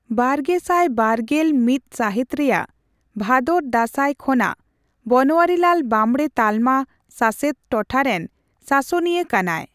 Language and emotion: Santali, neutral